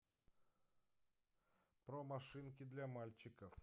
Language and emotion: Russian, neutral